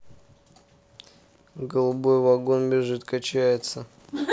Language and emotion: Russian, neutral